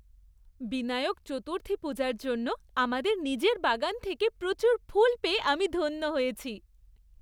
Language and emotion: Bengali, happy